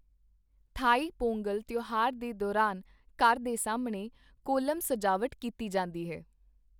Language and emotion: Punjabi, neutral